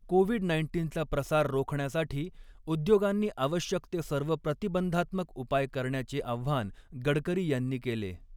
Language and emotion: Marathi, neutral